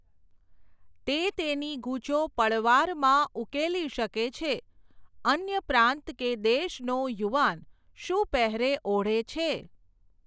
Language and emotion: Gujarati, neutral